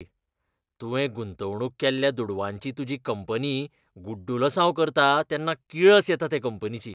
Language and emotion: Goan Konkani, disgusted